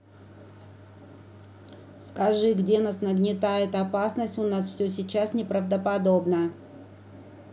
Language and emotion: Russian, neutral